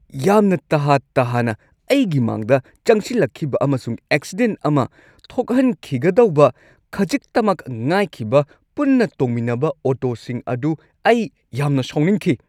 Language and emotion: Manipuri, angry